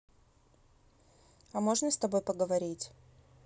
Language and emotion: Russian, neutral